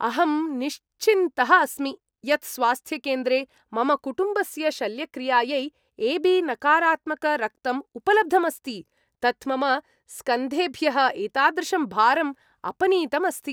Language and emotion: Sanskrit, happy